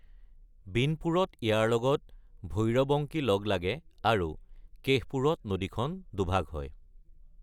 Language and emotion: Assamese, neutral